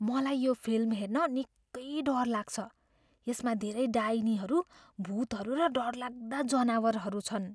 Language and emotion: Nepali, fearful